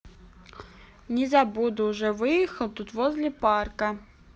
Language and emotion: Russian, neutral